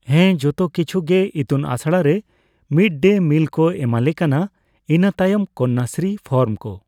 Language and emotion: Santali, neutral